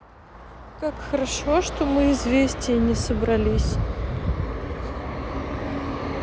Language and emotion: Russian, sad